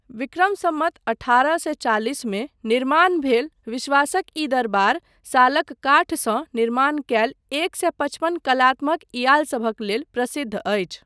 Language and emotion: Maithili, neutral